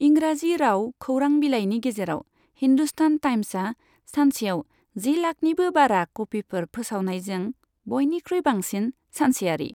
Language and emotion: Bodo, neutral